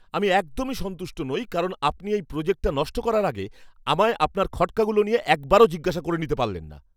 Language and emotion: Bengali, angry